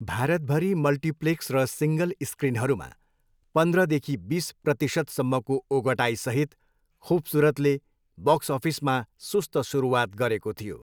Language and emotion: Nepali, neutral